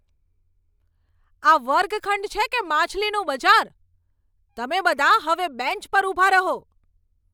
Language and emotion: Gujarati, angry